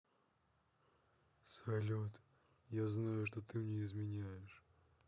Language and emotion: Russian, neutral